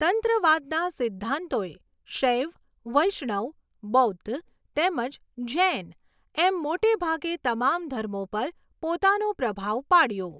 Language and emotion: Gujarati, neutral